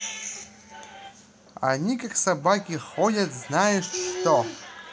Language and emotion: Russian, neutral